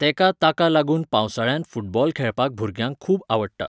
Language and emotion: Goan Konkani, neutral